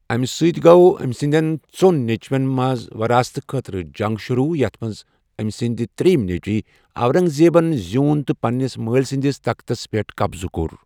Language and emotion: Kashmiri, neutral